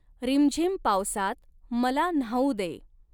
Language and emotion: Marathi, neutral